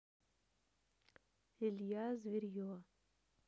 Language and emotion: Russian, neutral